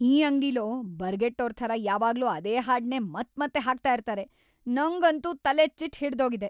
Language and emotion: Kannada, angry